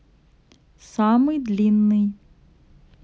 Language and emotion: Russian, neutral